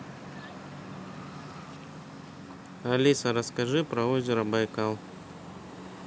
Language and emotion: Russian, neutral